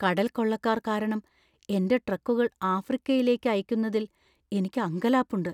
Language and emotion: Malayalam, fearful